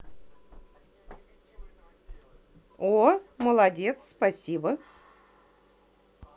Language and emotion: Russian, positive